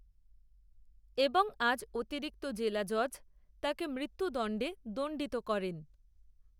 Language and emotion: Bengali, neutral